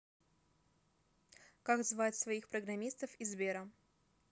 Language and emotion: Russian, neutral